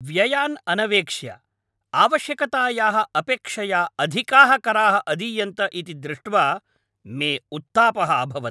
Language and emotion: Sanskrit, angry